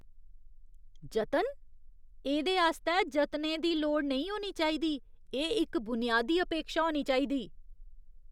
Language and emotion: Dogri, disgusted